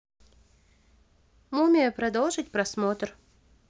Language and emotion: Russian, neutral